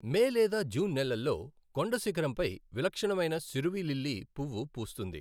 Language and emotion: Telugu, neutral